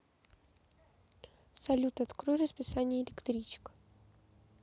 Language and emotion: Russian, neutral